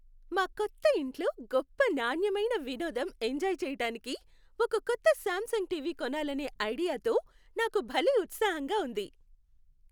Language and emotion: Telugu, happy